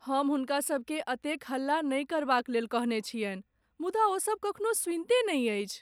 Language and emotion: Maithili, sad